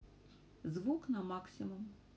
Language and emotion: Russian, neutral